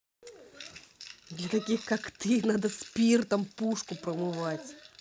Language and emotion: Russian, angry